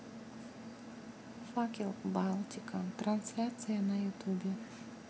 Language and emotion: Russian, neutral